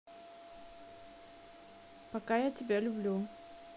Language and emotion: Russian, neutral